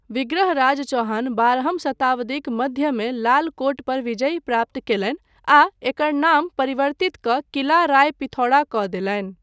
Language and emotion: Maithili, neutral